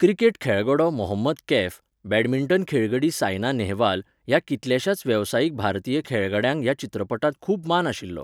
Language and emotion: Goan Konkani, neutral